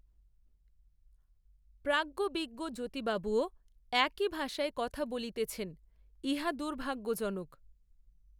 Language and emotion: Bengali, neutral